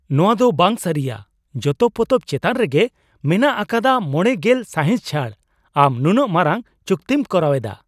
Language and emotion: Santali, surprised